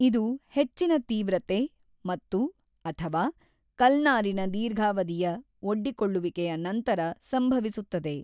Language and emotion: Kannada, neutral